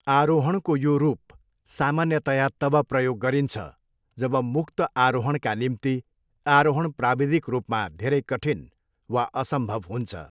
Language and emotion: Nepali, neutral